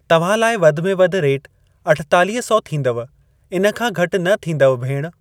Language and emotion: Sindhi, neutral